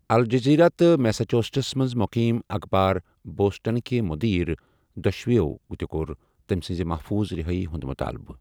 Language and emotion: Kashmiri, neutral